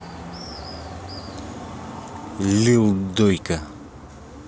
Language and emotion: Russian, angry